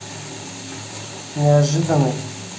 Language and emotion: Russian, neutral